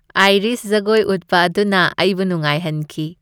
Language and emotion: Manipuri, happy